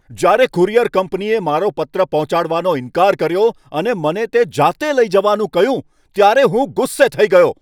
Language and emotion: Gujarati, angry